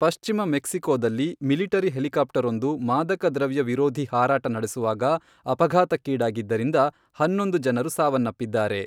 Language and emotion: Kannada, neutral